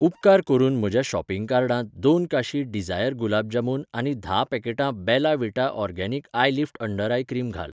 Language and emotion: Goan Konkani, neutral